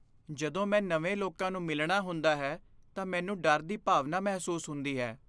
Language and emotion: Punjabi, fearful